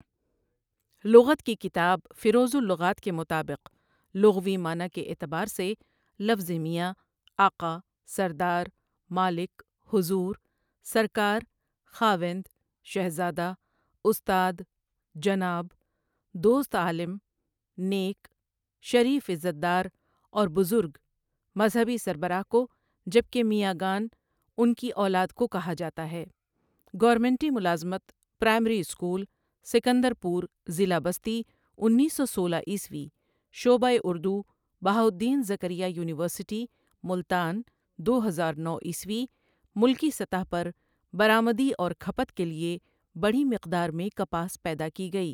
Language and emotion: Urdu, neutral